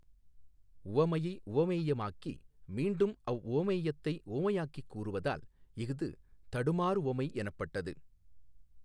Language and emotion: Tamil, neutral